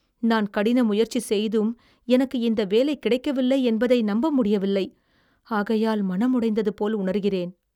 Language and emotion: Tamil, sad